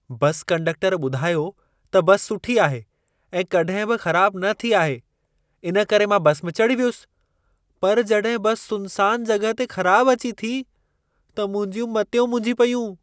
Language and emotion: Sindhi, surprised